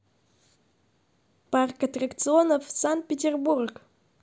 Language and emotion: Russian, positive